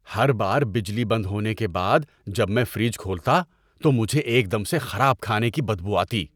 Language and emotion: Urdu, disgusted